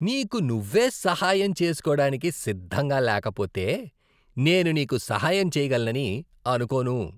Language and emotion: Telugu, disgusted